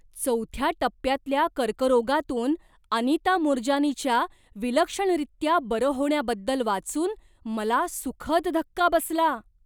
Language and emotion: Marathi, surprised